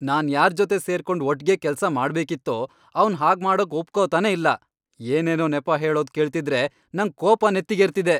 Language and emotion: Kannada, angry